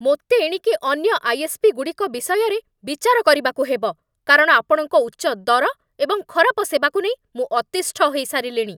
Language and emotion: Odia, angry